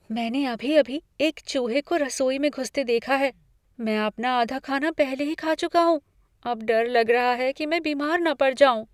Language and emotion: Hindi, fearful